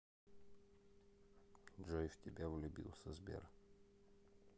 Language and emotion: Russian, neutral